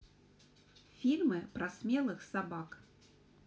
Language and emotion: Russian, neutral